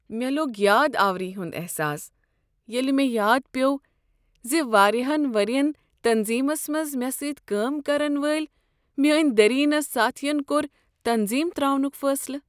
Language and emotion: Kashmiri, sad